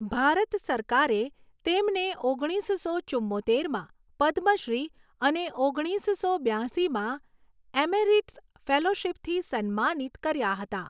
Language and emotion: Gujarati, neutral